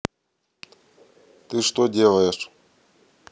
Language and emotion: Russian, neutral